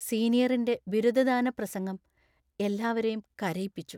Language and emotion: Malayalam, sad